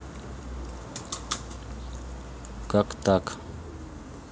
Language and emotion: Russian, neutral